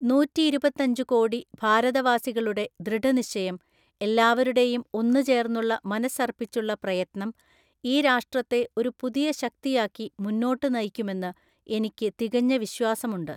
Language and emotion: Malayalam, neutral